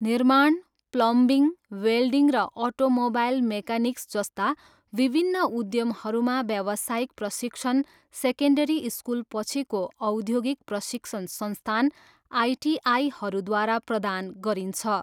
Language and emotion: Nepali, neutral